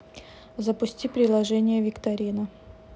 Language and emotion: Russian, neutral